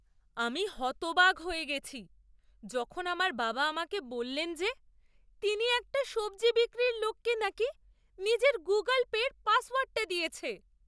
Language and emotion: Bengali, surprised